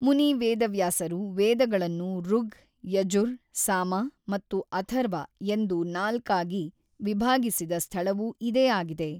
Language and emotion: Kannada, neutral